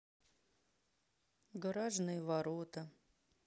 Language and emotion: Russian, sad